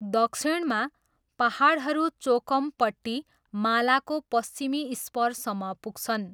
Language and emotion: Nepali, neutral